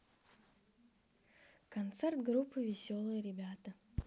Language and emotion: Russian, neutral